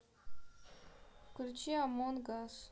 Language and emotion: Russian, neutral